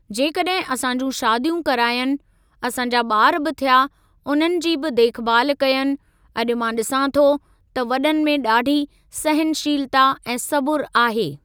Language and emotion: Sindhi, neutral